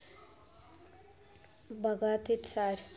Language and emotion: Russian, neutral